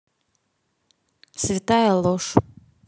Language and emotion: Russian, neutral